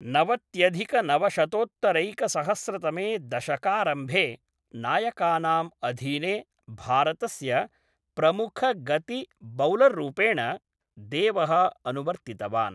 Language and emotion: Sanskrit, neutral